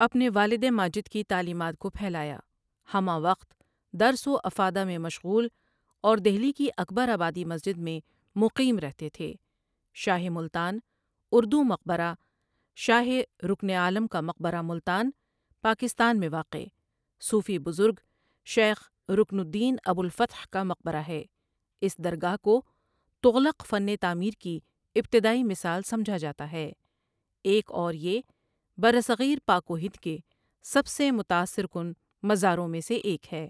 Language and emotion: Urdu, neutral